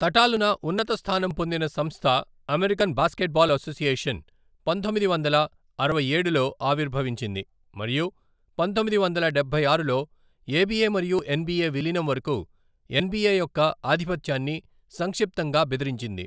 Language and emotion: Telugu, neutral